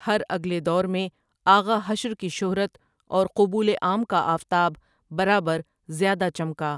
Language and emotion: Urdu, neutral